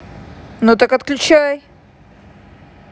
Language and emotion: Russian, angry